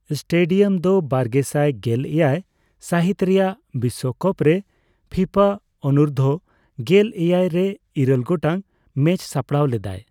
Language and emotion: Santali, neutral